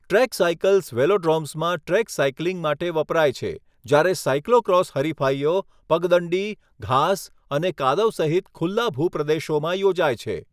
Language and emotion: Gujarati, neutral